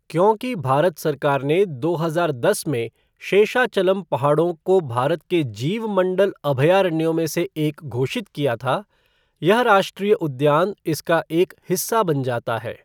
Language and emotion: Hindi, neutral